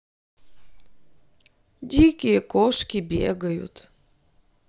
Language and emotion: Russian, sad